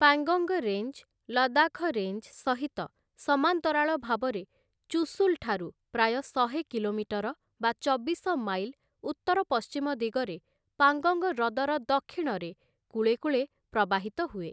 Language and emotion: Odia, neutral